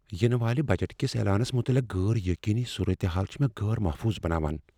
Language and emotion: Kashmiri, fearful